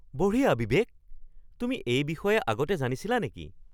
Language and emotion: Assamese, surprised